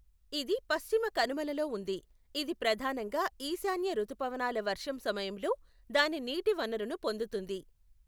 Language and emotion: Telugu, neutral